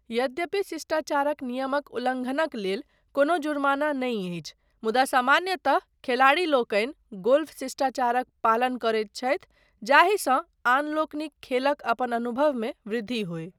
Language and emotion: Maithili, neutral